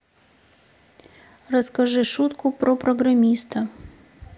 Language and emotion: Russian, sad